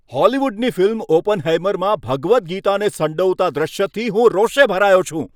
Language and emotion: Gujarati, angry